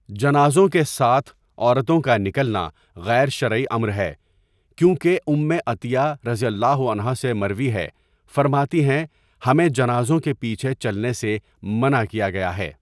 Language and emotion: Urdu, neutral